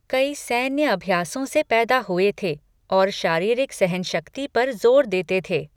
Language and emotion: Hindi, neutral